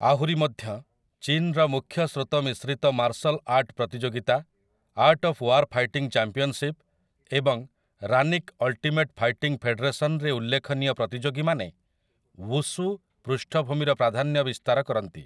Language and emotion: Odia, neutral